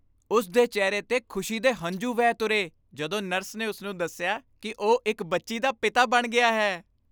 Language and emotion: Punjabi, happy